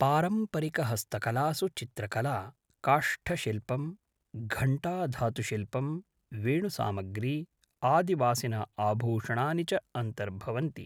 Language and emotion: Sanskrit, neutral